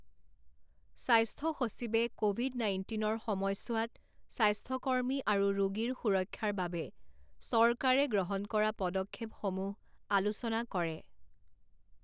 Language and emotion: Assamese, neutral